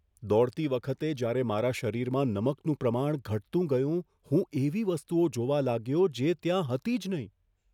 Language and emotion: Gujarati, fearful